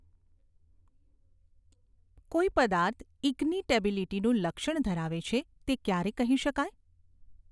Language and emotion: Gujarati, neutral